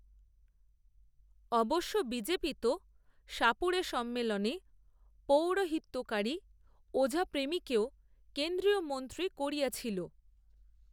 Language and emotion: Bengali, neutral